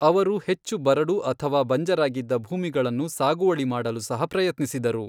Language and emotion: Kannada, neutral